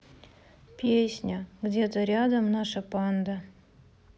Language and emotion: Russian, sad